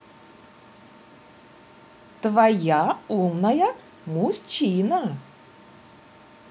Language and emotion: Russian, positive